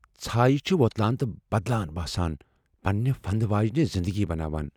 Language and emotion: Kashmiri, fearful